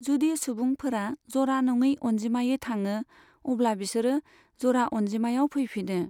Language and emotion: Bodo, neutral